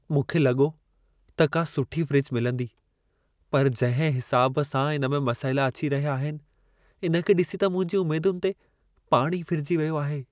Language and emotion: Sindhi, sad